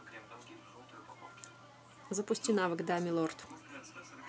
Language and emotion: Russian, neutral